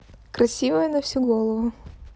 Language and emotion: Russian, neutral